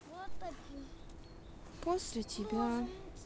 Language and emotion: Russian, sad